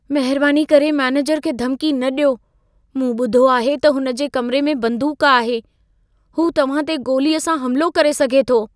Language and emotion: Sindhi, fearful